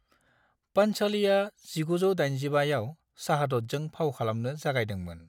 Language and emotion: Bodo, neutral